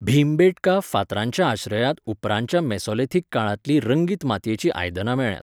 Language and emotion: Goan Konkani, neutral